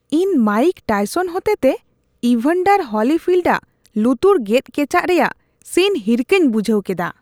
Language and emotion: Santali, disgusted